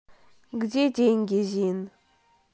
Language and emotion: Russian, neutral